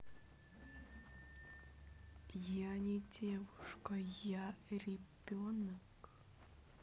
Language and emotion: Russian, neutral